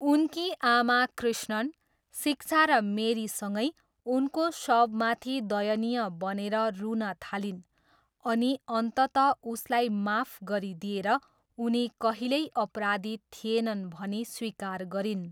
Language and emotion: Nepali, neutral